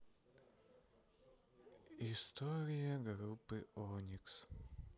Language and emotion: Russian, sad